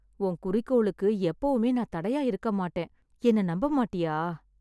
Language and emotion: Tamil, sad